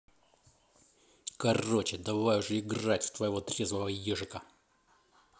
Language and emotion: Russian, angry